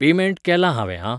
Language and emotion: Goan Konkani, neutral